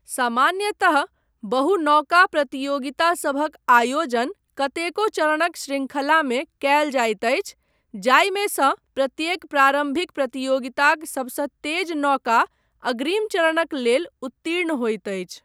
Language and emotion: Maithili, neutral